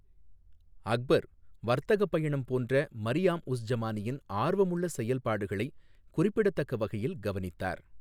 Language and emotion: Tamil, neutral